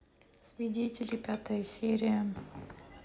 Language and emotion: Russian, neutral